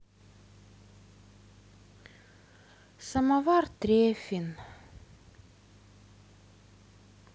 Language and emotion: Russian, sad